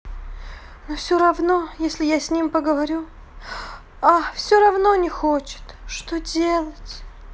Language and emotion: Russian, sad